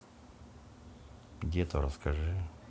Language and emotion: Russian, neutral